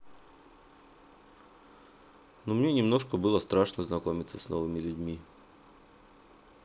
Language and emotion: Russian, neutral